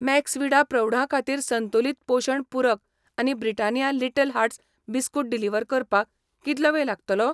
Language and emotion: Goan Konkani, neutral